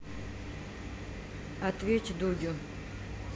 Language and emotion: Russian, neutral